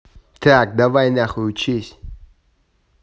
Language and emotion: Russian, angry